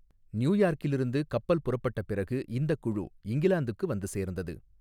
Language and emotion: Tamil, neutral